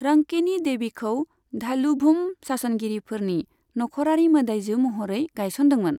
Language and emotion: Bodo, neutral